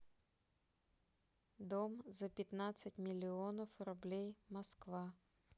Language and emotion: Russian, neutral